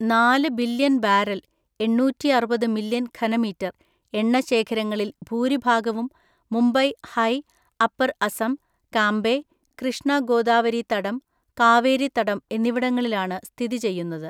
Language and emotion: Malayalam, neutral